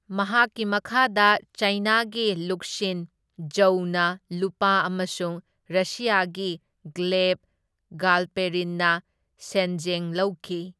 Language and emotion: Manipuri, neutral